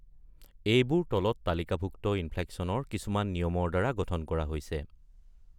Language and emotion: Assamese, neutral